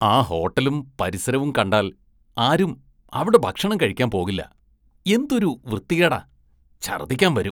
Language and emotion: Malayalam, disgusted